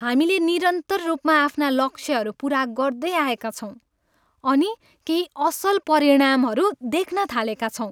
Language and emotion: Nepali, happy